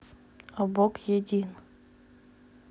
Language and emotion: Russian, neutral